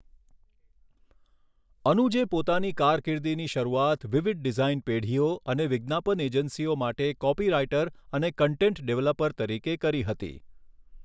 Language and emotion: Gujarati, neutral